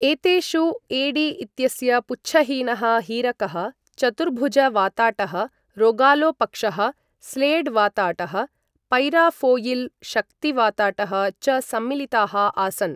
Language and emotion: Sanskrit, neutral